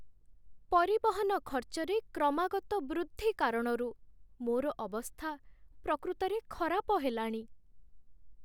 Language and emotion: Odia, sad